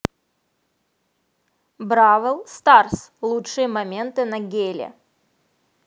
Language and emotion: Russian, positive